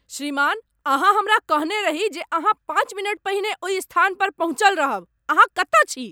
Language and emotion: Maithili, angry